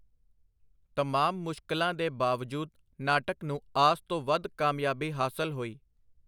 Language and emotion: Punjabi, neutral